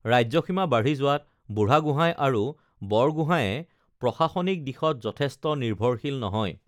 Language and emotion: Assamese, neutral